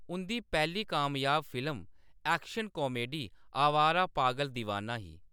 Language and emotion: Dogri, neutral